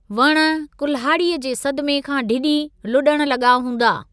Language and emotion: Sindhi, neutral